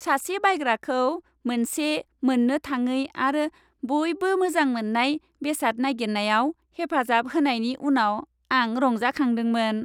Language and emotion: Bodo, happy